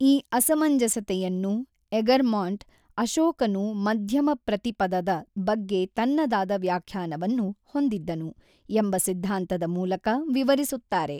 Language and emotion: Kannada, neutral